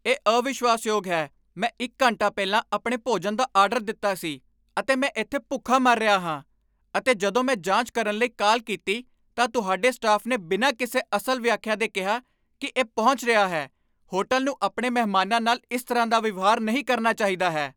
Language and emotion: Punjabi, angry